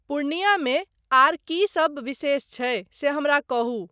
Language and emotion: Maithili, neutral